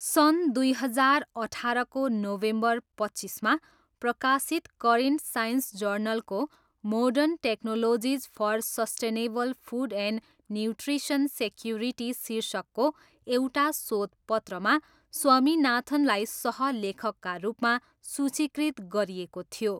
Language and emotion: Nepali, neutral